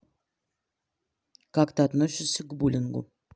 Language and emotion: Russian, neutral